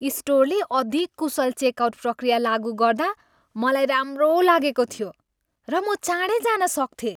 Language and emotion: Nepali, happy